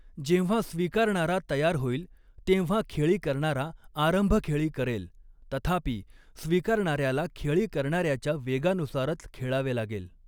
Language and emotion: Marathi, neutral